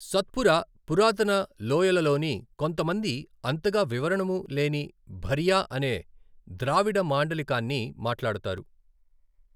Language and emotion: Telugu, neutral